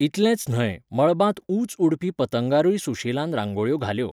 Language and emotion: Goan Konkani, neutral